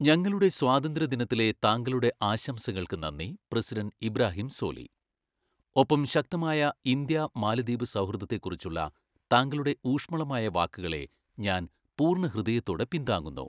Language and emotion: Malayalam, neutral